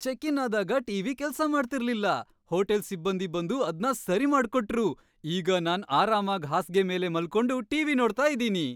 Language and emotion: Kannada, happy